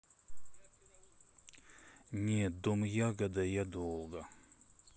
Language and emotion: Russian, neutral